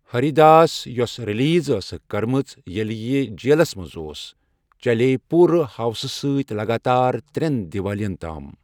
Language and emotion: Kashmiri, neutral